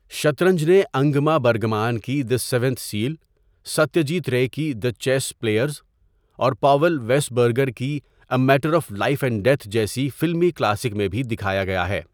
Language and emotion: Urdu, neutral